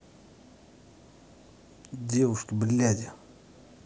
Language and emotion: Russian, angry